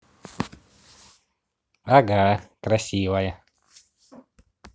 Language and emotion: Russian, positive